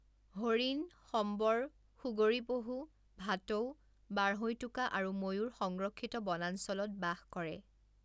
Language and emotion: Assamese, neutral